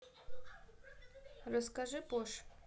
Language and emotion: Russian, neutral